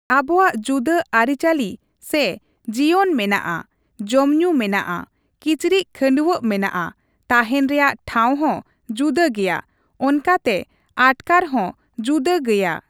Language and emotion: Santali, neutral